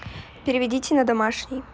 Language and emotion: Russian, neutral